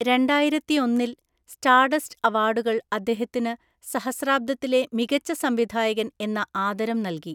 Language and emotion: Malayalam, neutral